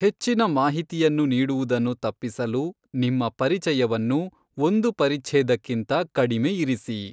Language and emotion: Kannada, neutral